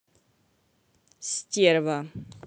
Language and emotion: Russian, neutral